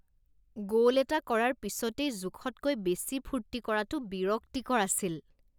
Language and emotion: Assamese, disgusted